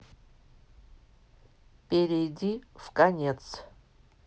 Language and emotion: Russian, neutral